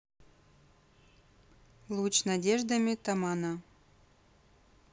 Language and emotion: Russian, neutral